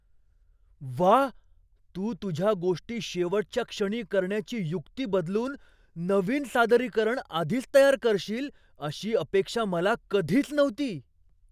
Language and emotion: Marathi, surprised